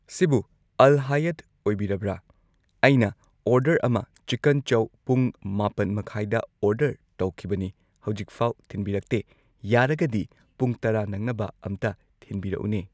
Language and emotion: Manipuri, neutral